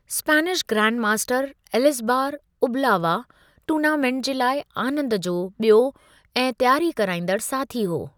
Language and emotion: Sindhi, neutral